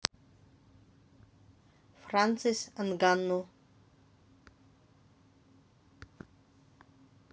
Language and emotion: Russian, neutral